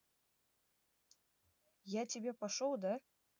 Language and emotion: Russian, neutral